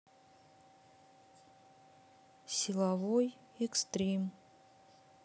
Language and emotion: Russian, neutral